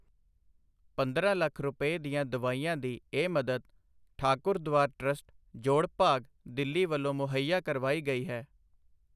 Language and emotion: Punjabi, neutral